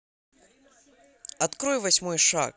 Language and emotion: Russian, positive